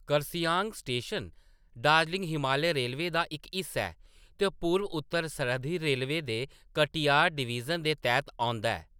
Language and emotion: Dogri, neutral